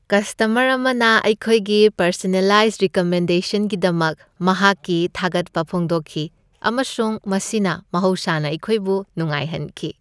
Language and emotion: Manipuri, happy